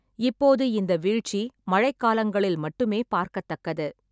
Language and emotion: Tamil, neutral